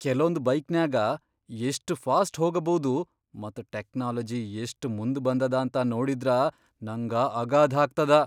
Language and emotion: Kannada, surprised